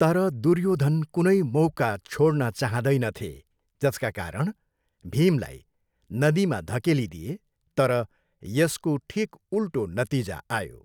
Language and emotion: Nepali, neutral